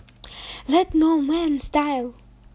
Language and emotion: Russian, positive